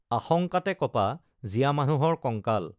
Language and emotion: Assamese, neutral